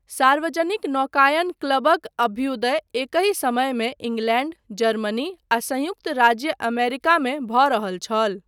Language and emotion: Maithili, neutral